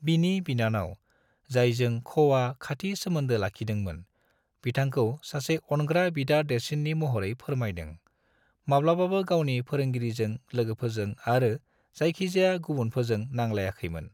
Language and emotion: Bodo, neutral